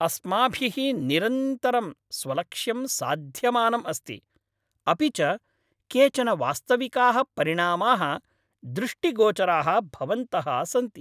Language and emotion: Sanskrit, happy